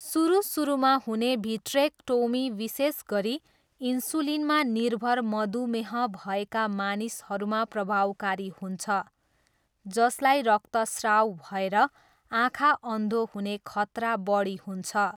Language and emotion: Nepali, neutral